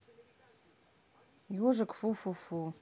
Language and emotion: Russian, neutral